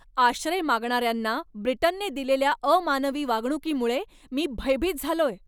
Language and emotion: Marathi, angry